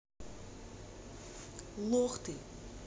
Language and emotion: Russian, neutral